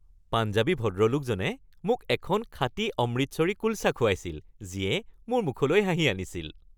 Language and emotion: Assamese, happy